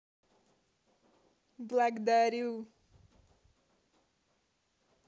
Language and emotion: Russian, positive